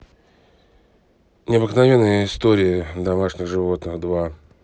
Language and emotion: Russian, neutral